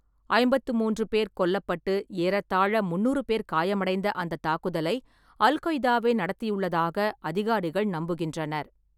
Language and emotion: Tamil, neutral